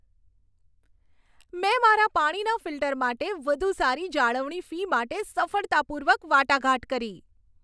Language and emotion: Gujarati, happy